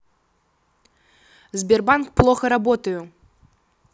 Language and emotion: Russian, angry